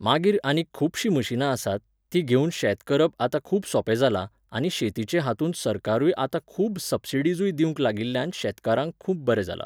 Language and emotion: Goan Konkani, neutral